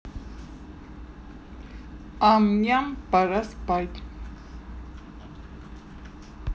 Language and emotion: Russian, neutral